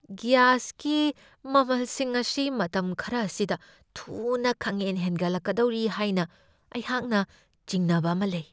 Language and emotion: Manipuri, fearful